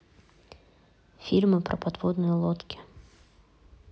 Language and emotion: Russian, neutral